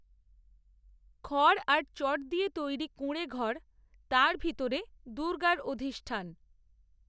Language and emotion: Bengali, neutral